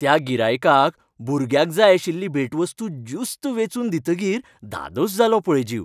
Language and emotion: Goan Konkani, happy